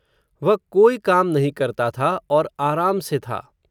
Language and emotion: Hindi, neutral